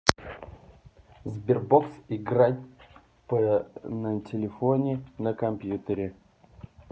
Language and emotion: Russian, neutral